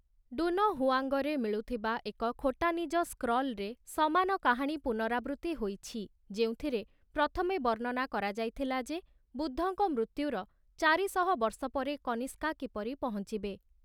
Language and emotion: Odia, neutral